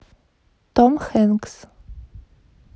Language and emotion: Russian, neutral